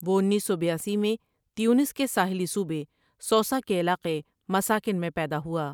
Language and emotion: Urdu, neutral